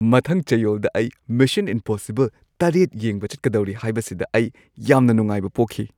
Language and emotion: Manipuri, happy